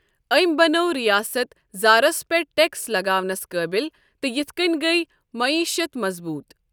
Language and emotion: Kashmiri, neutral